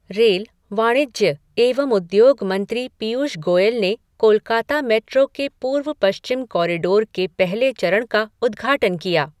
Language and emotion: Hindi, neutral